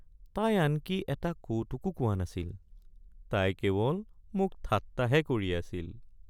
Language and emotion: Assamese, sad